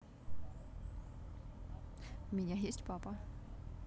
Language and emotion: Russian, positive